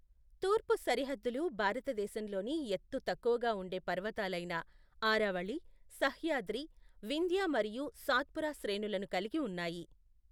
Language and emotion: Telugu, neutral